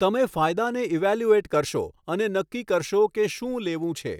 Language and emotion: Gujarati, neutral